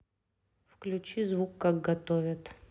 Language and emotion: Russian, neutral